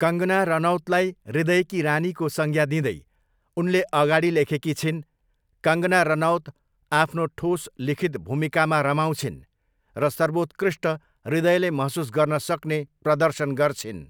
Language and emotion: Nepali, neutral